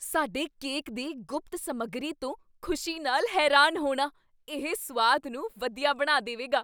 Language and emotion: Punjabi, surprised